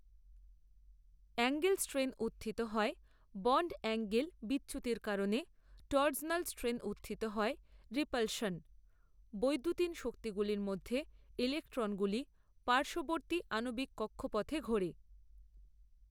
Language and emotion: Bengali, neutral